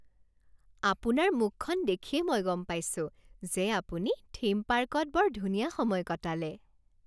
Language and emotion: Assamese, happy